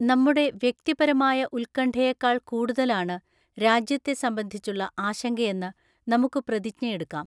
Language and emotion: Malayalam, neutral